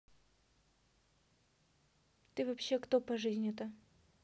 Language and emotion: Russian, neutral